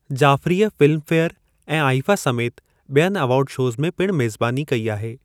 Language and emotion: Sindhi, neutral